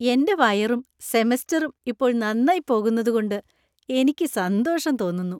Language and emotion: Malayalam, happy